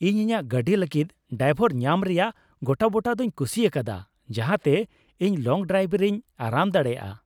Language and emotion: Santali, happy